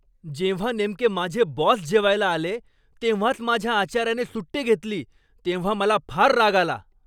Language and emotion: Marathi, angry